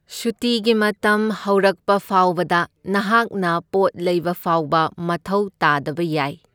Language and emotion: Manipuri, neutral